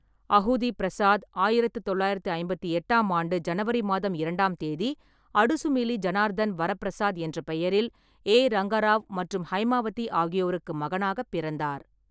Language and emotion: Tamil, neutral